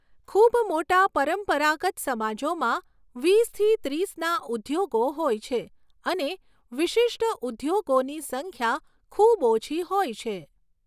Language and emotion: Gujarati, neutral